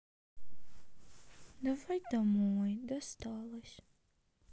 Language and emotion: Russian, sad